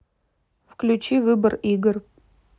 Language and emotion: Russian, neutral